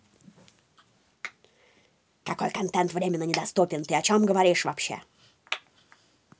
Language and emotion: Russian, angry